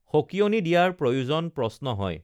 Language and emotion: Assamese, neutral